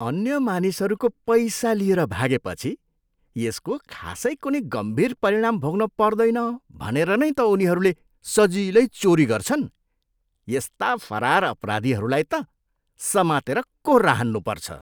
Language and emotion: Nepali, disgusted